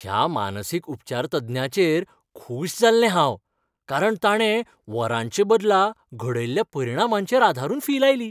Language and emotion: Goan Konkani, happy